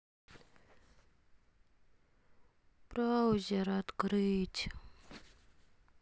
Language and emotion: Russian, sad